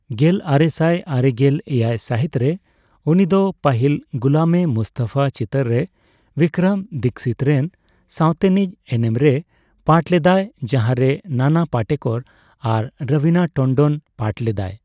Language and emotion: Santali, neutral